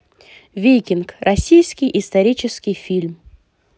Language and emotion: Russian, positive